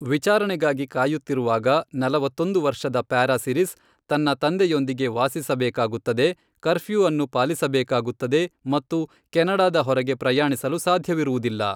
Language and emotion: Kannada, neutral